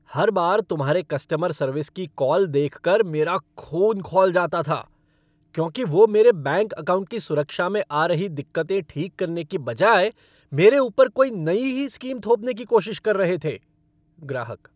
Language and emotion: Hindi, angry